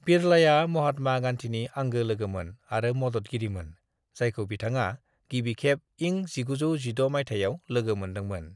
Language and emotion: Bodo, neutral